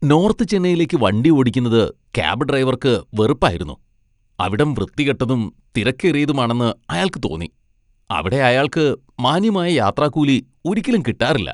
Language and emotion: Malayalam, disgusted